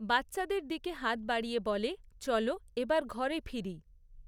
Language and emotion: Bengali, neutral